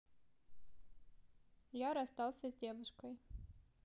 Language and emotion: Russian, neutral